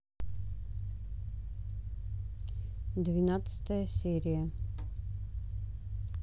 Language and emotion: Russian, neutral